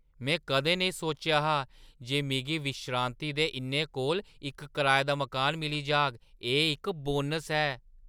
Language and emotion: Dogri, surprised